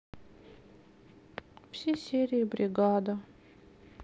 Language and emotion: Russian, sad